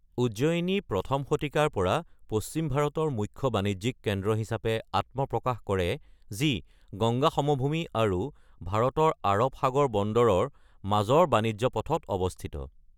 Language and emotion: Assamese, neutral